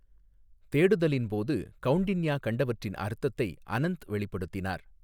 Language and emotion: Tamil, neutral